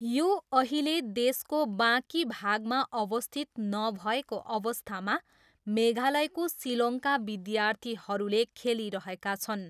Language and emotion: Nepali, neutral